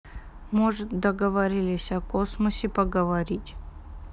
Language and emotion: Russian, sad